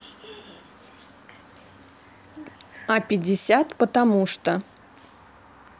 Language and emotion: Russian, neutral